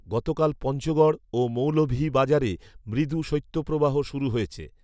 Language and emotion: Bengali, neutral